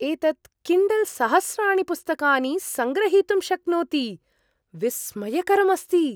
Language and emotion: Sanskrit, surprised